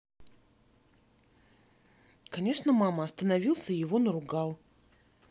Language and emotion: Russian, neutral